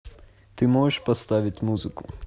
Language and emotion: Russian, neutral